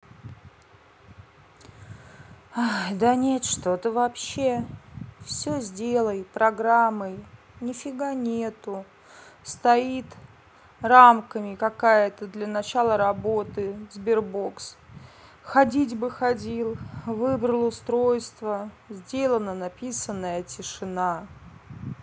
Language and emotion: Russian, sad